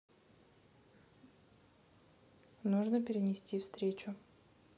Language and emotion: Russian, neutral